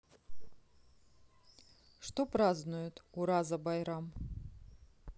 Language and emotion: Russian, neutral